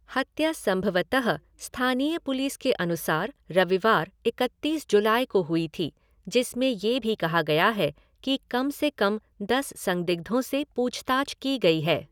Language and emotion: Hindi, neutral